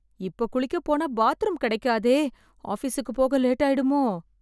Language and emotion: Tamil, fearful